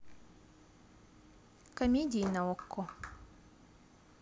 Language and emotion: Russian, neutral